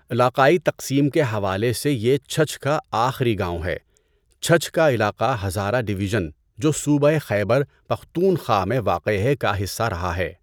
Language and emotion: Urdu, neutral